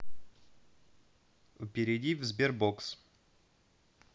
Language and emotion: Russian, neutral